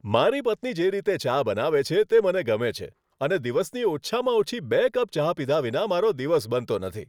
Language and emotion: Gujarati, happy